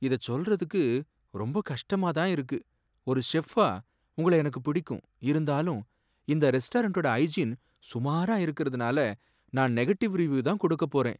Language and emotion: Tamil, sad